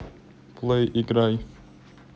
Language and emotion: Russian, neutral